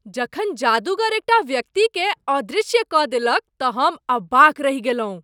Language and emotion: Maithili, surprised